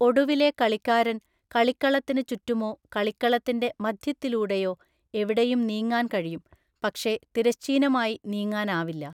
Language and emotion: Malayalam, neutral